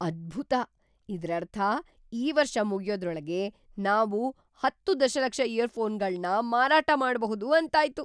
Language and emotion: Kannada, surprised